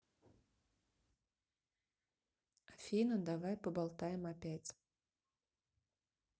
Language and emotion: Russian, neutral